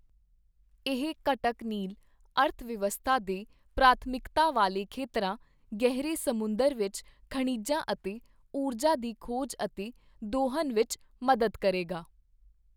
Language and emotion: Punjabi, neutral